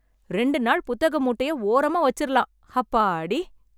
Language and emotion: Tamil, happy